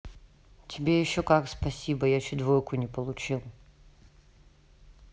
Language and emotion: Russian, neutral